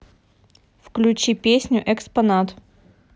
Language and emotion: Russian, neutral